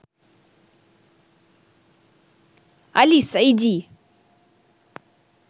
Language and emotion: Russian, angry